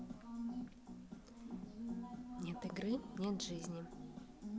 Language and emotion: Russian, neutral